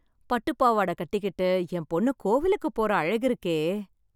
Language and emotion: Tamil, happy